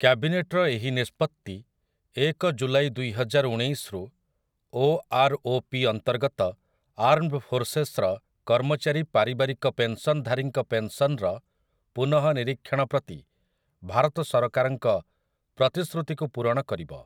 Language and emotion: Odia, neutral